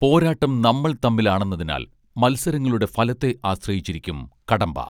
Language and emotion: Malayalam, neutral